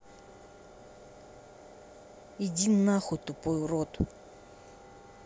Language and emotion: Russian, angry